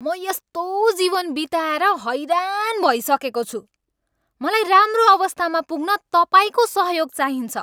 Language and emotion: Nepali, angry